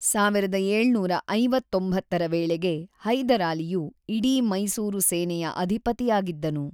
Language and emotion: Kannada, neutral